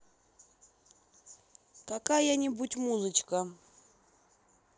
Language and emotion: Russian, neutral